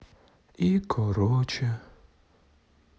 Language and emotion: Russian, sad